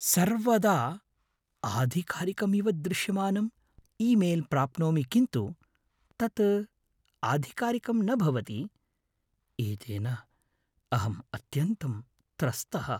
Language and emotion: Sanskrit, fearful